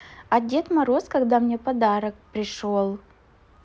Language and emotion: Russian, positive